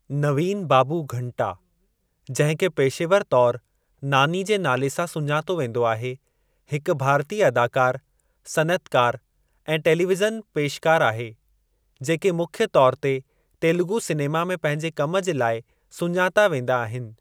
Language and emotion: Sindhi, neutral